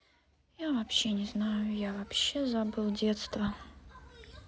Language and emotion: Russian, sad